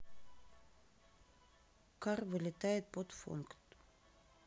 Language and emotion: Russian, neutral